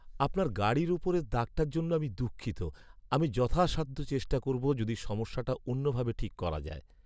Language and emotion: Bengali, sad